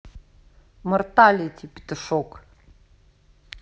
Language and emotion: Russian, angry